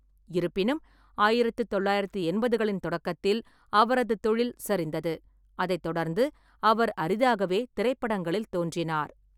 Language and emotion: Tamil, neutral